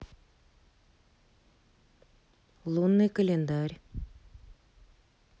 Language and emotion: Russian, neutral